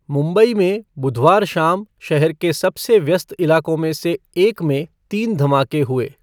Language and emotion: Hindi, neutral